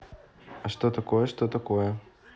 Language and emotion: Russian, neutral